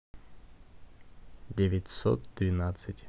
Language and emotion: Russian, neutral